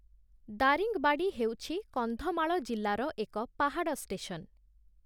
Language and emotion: Odia, neutral